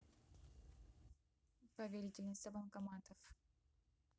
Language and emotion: Russian, neutral